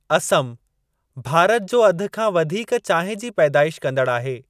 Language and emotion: Sindhi, neutral